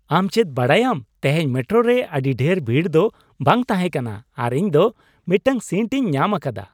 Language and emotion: Santali, happy